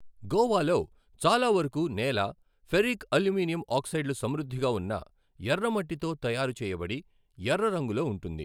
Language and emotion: Telugu, neutral